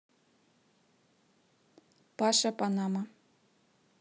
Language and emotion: Russian, neutral